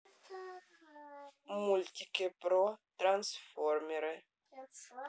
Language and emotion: Russian, neutral